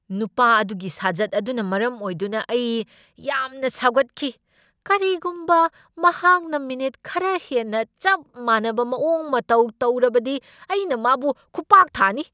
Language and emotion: Manipuri, angry